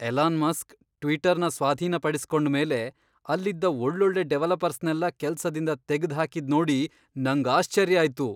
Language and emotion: Kannada, surprised